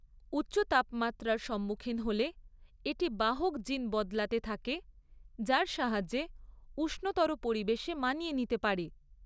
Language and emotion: Bengali, neutral